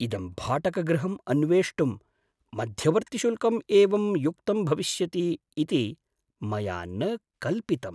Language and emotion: Sanskrit, surprised